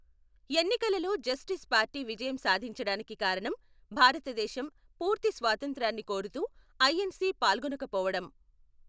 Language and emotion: Telugu, neutral